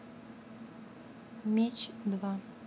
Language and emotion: Russian, neutral